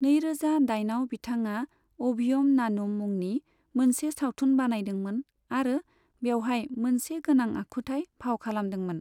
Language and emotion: Bodo, neutral